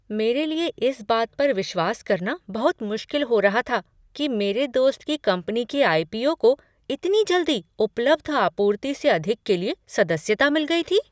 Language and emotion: Hindi, surprised